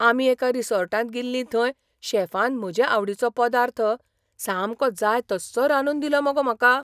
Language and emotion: Goan Konkani, surprised